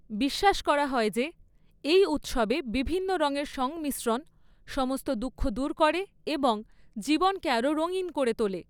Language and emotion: Bengali, neutral